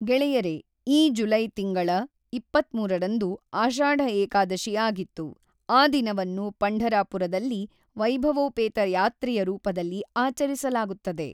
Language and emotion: Kannada, neutral